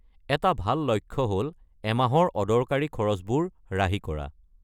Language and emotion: Assamese, neutral